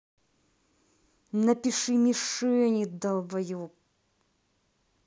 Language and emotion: Russian, angry